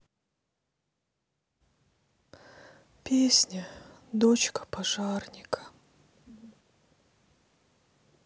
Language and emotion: Russian, sad